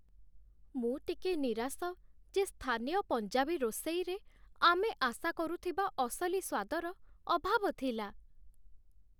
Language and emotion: Odia, sad